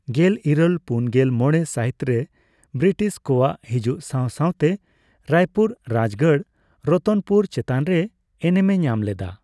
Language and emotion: Santali, neutral